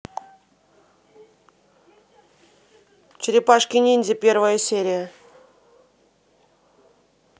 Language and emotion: Russian, neutral